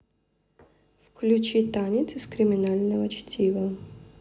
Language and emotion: Russian, neutral